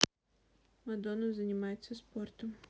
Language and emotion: Russian, neutral